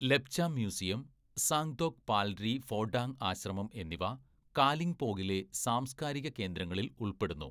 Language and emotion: Malayalam, neutral